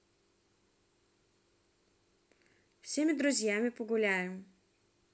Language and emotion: Russian, neutral